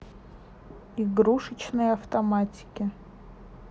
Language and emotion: Russian, neutral